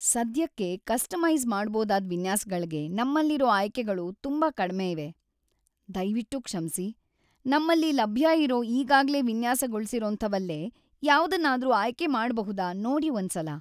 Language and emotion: Kannada, sad